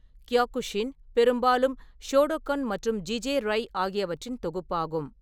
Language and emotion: Tamil, neutral